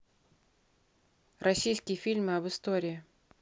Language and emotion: Russian, neutral